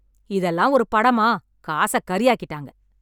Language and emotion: Tamil, angry